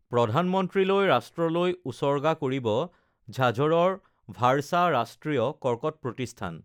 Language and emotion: Assamese, neutral